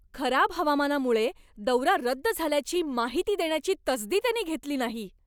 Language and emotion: Marathi, angry